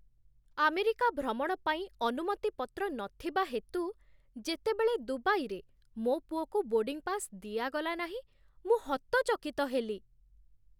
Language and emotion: Odia, surprised